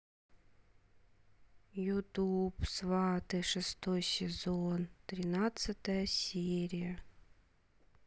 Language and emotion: Russian, sad